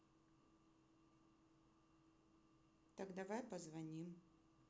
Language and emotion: Russian, neutral